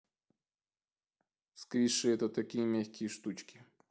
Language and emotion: Russian, neutral